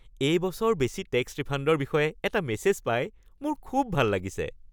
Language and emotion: Assamese, happy